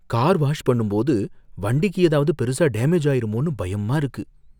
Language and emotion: Tamil, fearful